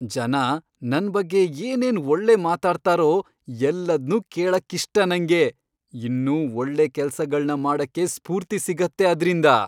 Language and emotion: Kannada, happy